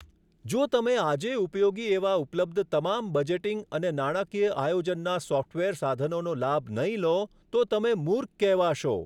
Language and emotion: Gujarati, neutral